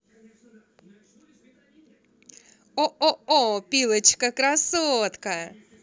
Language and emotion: Russian, positive